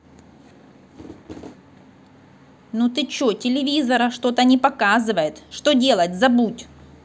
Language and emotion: Russian, angry